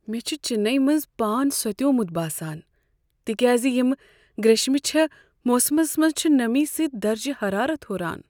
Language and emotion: Kashmiri, sad